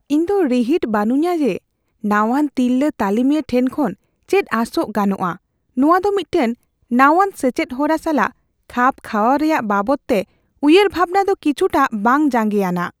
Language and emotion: Santali, fearful